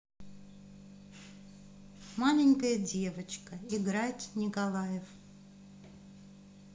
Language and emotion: Russian, neutral